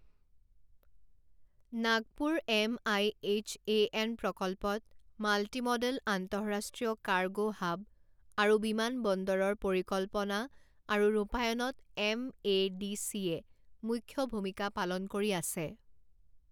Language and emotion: Assamese, neutral